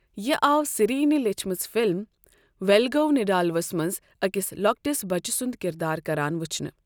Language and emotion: Kashmiri, neutral